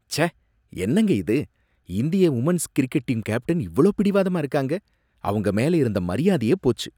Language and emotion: Tamil, disgusted